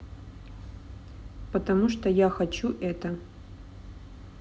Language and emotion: Russian, neutral